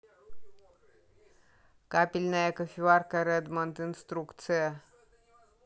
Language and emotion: Russian, neutral